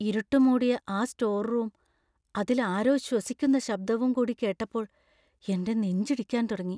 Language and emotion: Malayalam, fearful